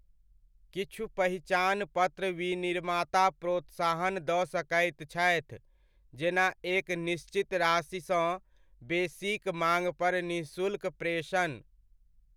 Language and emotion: Maithili, neutral